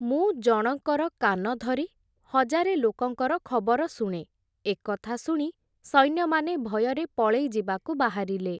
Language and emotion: Odia, neutral